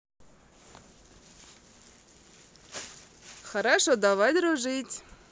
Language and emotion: Russian, positive